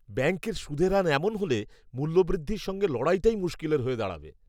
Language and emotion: Bengali, disgusted